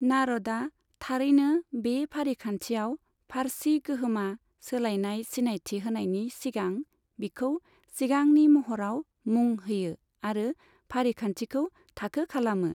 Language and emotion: Bodo, neutral